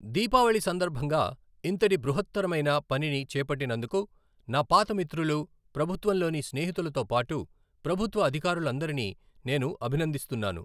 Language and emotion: Telugu, neutral